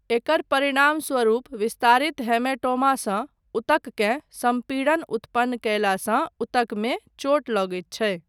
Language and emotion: Maithili, neutral